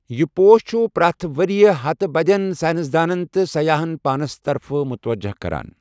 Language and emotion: Kashmiri, neutral